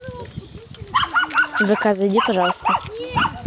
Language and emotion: Russian, neutral